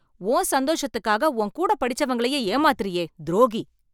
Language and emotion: Tamil, angry